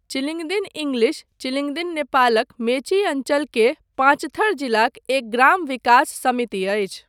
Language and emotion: Maithili, neutral